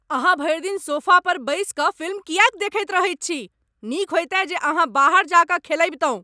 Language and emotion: Maithili, angry